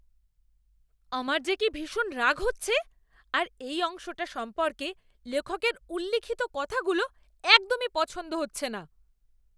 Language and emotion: Bengali, angry